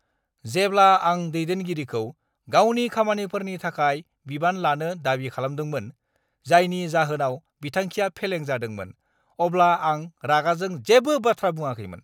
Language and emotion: Bodo, angry